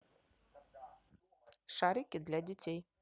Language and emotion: Russian, neutral